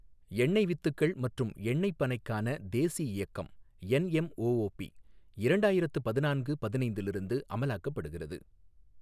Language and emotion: Tamil, neutral